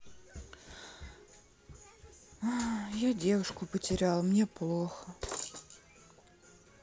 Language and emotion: Russian, sad